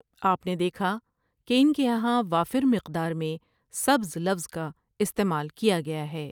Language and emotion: Urdu, neutral